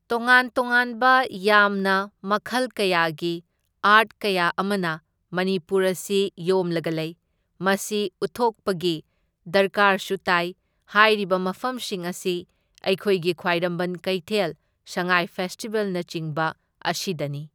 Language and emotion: Manipuri, neutral